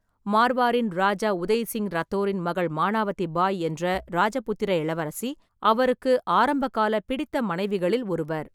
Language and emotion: Tamil, neutral